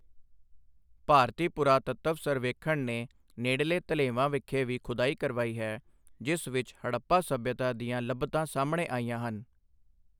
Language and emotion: Punjabi, neutral